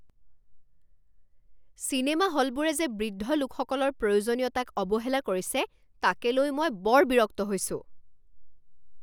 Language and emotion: Assamese, angry